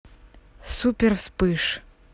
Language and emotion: Russian, neutral